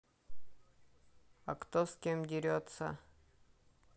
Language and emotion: Russian, neutral